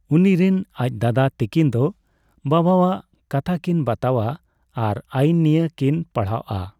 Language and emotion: Santali, neutral